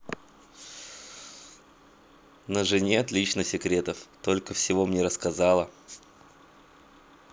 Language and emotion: Russian, positive